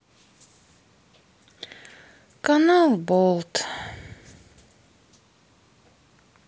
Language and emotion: Russian, sad